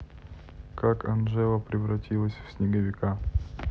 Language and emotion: Russian, neutral